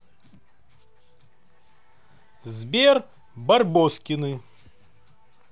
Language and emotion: Russian, positive